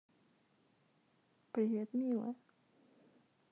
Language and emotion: Russian, sad